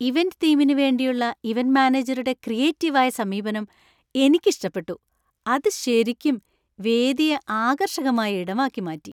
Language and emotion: Malayalam, happy